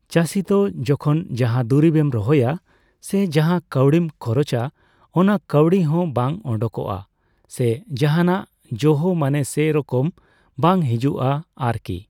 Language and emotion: Santali, neutral